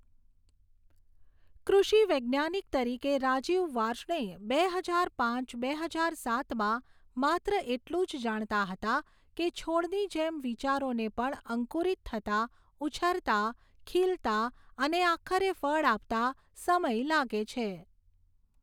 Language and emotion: Gujarati, neutral